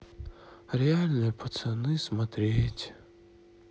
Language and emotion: Russian, sad